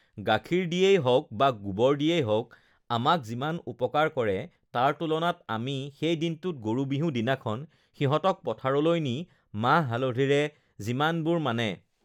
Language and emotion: Assamese, neutral